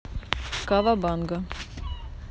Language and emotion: Russian, neutral